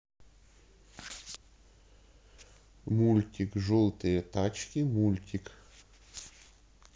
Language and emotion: Russian, neutral